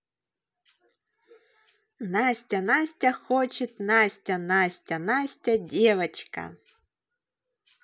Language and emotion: Russian, positive